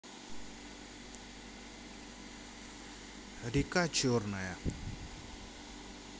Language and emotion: Russian, neutral